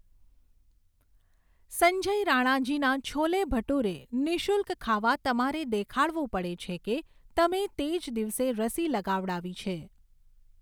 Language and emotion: Gujarati, neutral